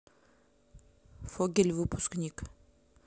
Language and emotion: Russian, neutral